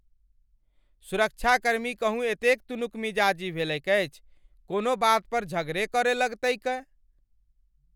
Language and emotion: Maithili, angry